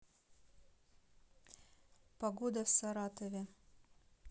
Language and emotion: Russian, neutral